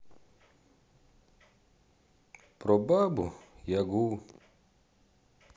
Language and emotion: Russian, sad